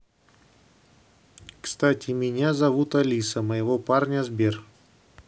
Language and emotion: Russian, neutral